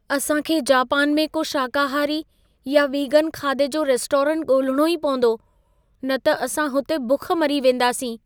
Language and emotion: Sindhi, fearful